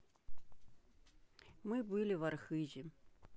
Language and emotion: Russian, neutral